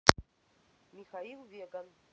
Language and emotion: Russian, neutral